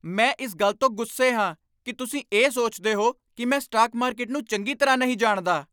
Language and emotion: Punjabi, angry